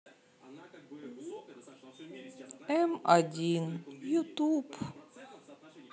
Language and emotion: Russian, sad